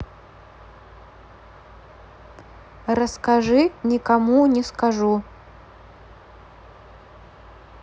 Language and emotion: Russian, neutral